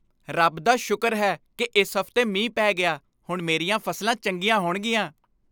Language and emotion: Punjabi, happy